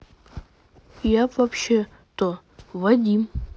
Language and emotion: Russian, neutral